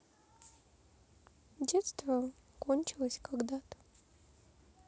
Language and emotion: Russian, sad